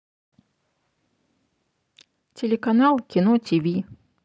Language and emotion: Russian, neutral